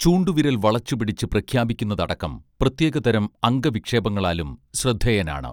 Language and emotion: Malayalam, neutral